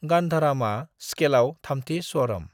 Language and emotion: Bodo, neutral